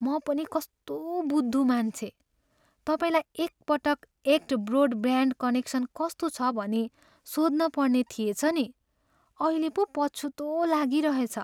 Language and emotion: Nepali, sad